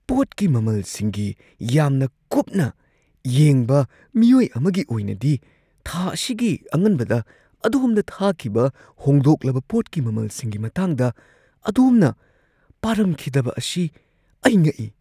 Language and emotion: Manipuri, surprised